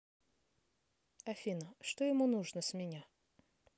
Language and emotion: Russian, neutral